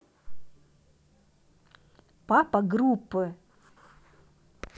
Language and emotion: Russian, neutral